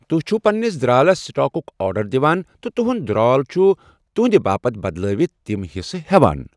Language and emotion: Kashmiri, neutral